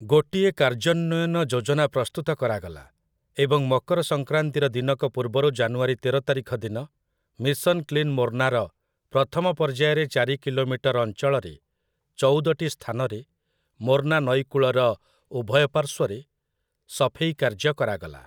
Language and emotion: Odia, neutral